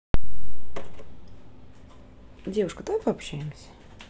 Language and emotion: Russian, neutral